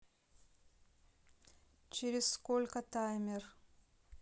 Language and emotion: Russian, neutral